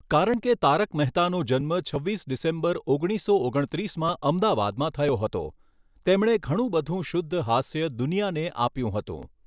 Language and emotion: Gujarati, neutral